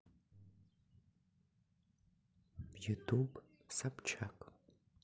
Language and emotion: Russian, neutral